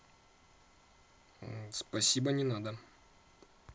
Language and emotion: Russian, neutral